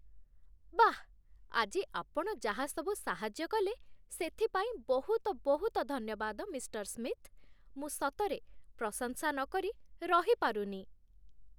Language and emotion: Odia, happy